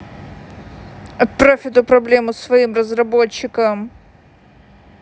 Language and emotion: Russian, angry